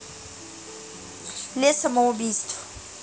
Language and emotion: Russian, neutral